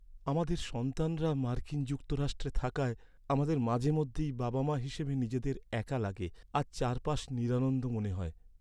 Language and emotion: Bengali, sad